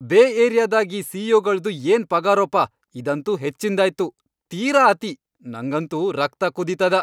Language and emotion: Kannada, angry